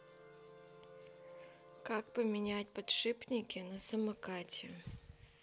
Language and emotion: Russian, neutral